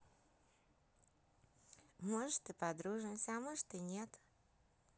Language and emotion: Russian, positive